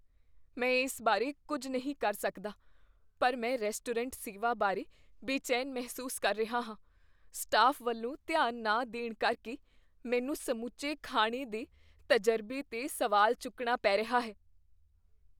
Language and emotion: Punjabi, fearful